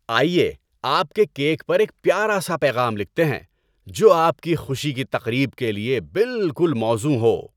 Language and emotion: Urdu, happy